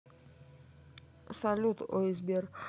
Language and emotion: Russian, neutral